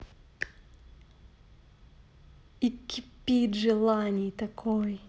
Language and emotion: Russian, neutral